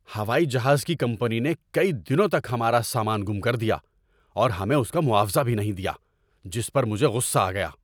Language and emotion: Urdu, angry